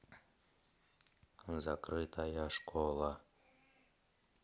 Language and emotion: Russian, neutral